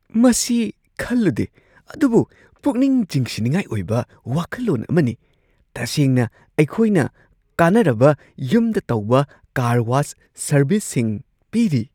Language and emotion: Manipuri, surprised